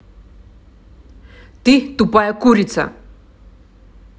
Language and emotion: Russian, angry